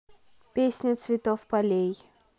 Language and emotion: Russian, neutral